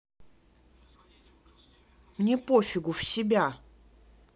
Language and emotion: Russian, angry